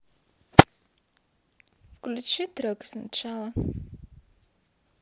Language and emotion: Russian, neutral